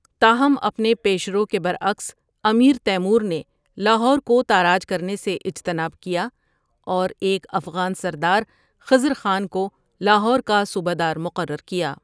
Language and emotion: Urdu, neutral